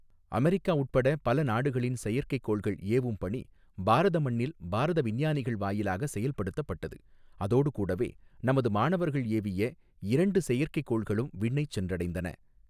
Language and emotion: Tamil, neutral